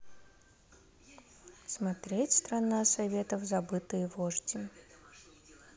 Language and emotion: Russian, neutral